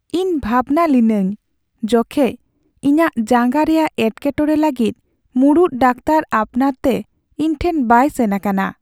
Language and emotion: Santali, sad